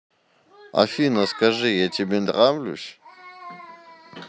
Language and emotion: Russian, neutral